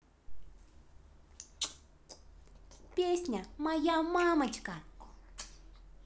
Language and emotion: Russian, positive